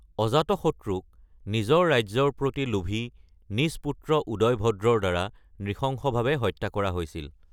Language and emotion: Assamese, neutral